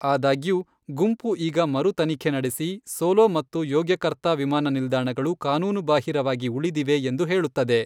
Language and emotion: Kannada, neutral